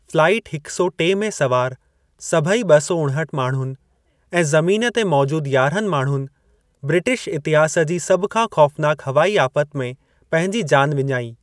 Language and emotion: Sindhi, neutral